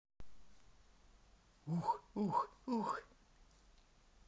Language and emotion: Russian, positive